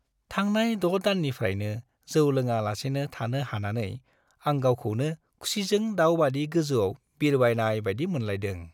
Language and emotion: Bodo, happy